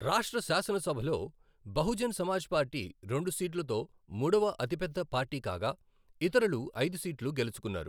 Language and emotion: Telugu, neutral